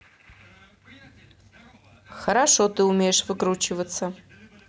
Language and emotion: Russian, neutral